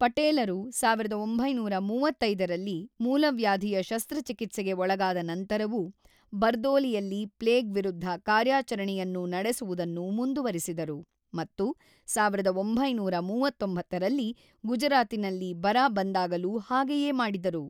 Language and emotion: Kannada, neutral